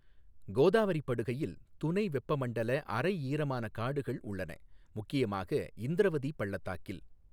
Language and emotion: Tamil, neutral